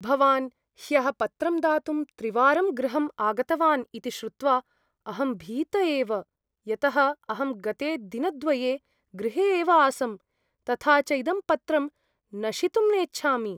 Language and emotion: Sanskrit, fearful